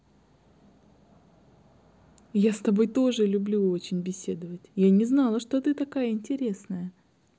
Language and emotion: Russian, positive